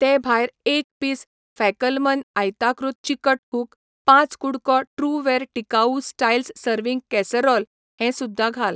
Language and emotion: Goan Konkani, neutral